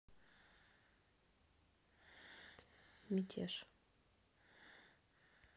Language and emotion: Russian, neutral